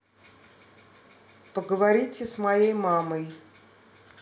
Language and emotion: Russian, neutral